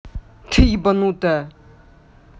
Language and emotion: Russian, angry